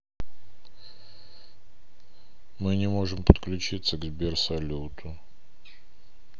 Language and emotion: Russian, sad